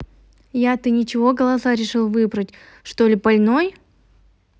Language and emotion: Russian, neutral